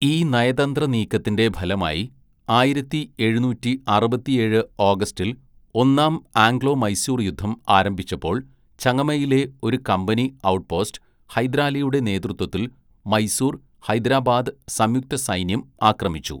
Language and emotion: Malayalam, neutral